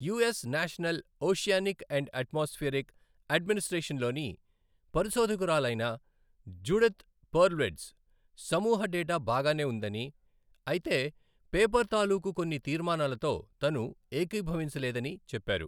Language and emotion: Telugu, neutral